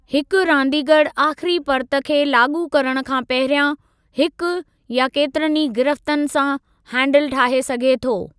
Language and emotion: Sindhi, neutral